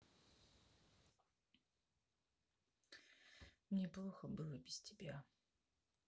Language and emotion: Russian, sad